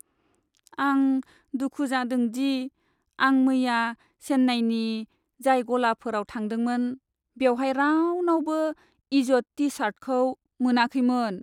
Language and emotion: Bodo, sad